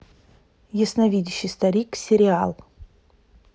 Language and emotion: Russian, neutral